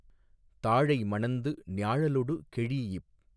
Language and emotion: Tamil, neutral